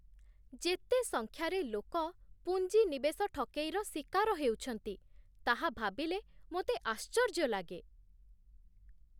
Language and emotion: Odia, surprised